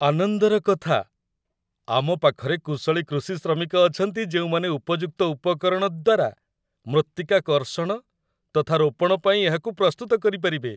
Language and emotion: Odia, happy